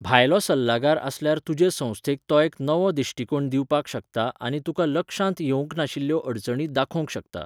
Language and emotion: Goan Konkani, neutral